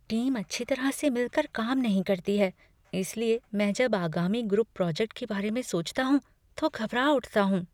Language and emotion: Hindi, fearful